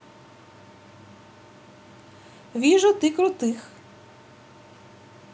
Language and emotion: Russian, positive